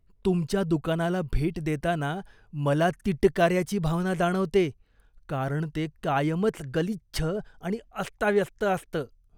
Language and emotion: Marathi, disgusted